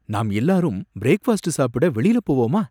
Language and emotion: Tamil, surprised